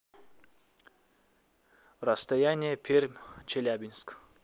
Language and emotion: Russian, neutral